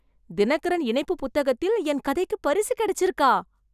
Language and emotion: Tamil, surprised